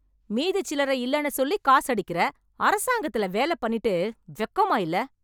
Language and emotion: Tamil, angry